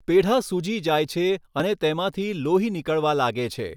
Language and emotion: Gujarati, neutral